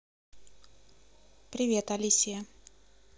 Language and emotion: Russian, positive